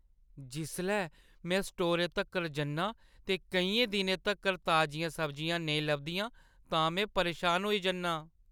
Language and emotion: Dogri, sad